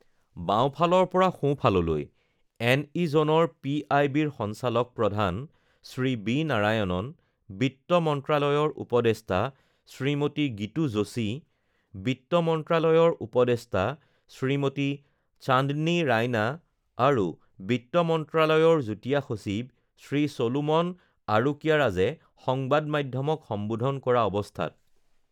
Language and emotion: Assamese, neutral